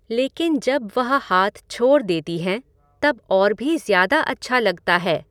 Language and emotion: Hindi, neutral